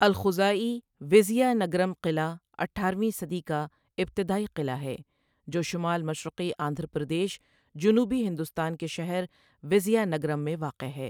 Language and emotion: Urdu, neutral